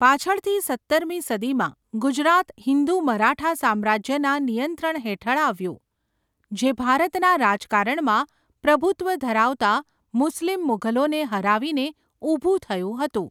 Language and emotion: Gujarati, neutral